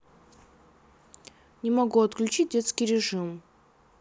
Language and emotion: Russian, neutral